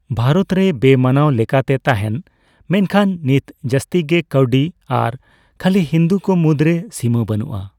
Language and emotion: Santali, neutral